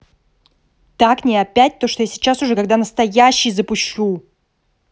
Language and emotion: Russian, angry